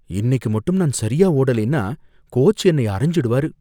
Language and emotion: Tamil, fearful